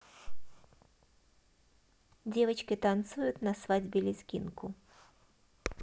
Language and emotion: Russian, positive